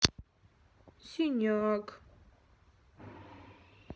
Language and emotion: Russian, sad